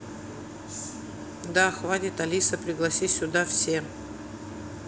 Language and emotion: Russian, neutral